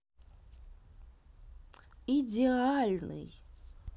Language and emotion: Russian, neutral